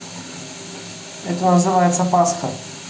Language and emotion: Russian, neutral